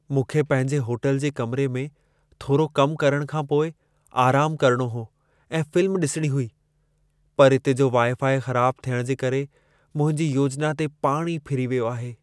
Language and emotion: Sindhi, sad